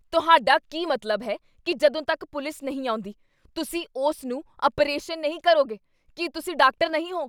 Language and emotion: Punjabi, angry